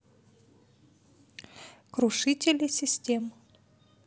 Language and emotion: Russian, neutral